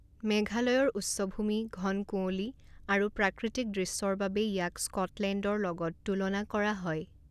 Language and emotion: Assamese, neutral